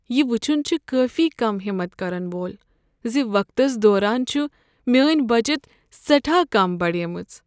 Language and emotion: Kashmiri, sad